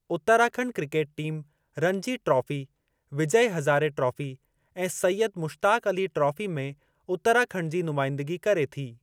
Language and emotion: Sindhi, neutral